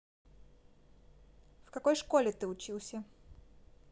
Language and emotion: Russian, neutral